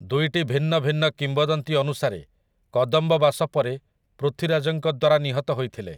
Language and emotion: Odia, neutral